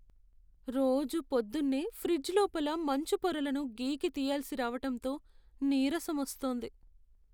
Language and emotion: Telugu, sad